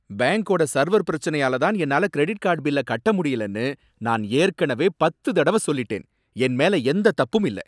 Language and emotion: Tamil, angry